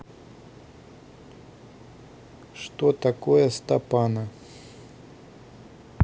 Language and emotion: Russian, neutral